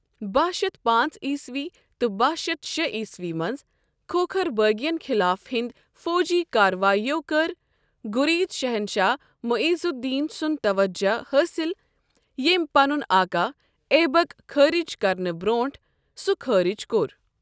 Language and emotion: Kashmiri, neutral